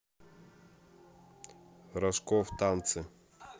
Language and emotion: Russian, neutral